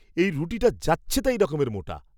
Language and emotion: Bengali, disgusted